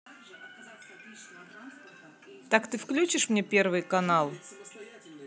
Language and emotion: Russian, angry